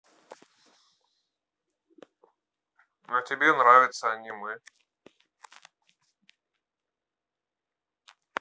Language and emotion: Russian, neutral